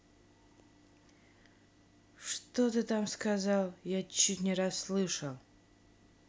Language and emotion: Russian, angry